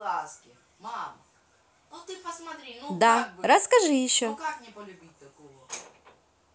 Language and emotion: Russian, positive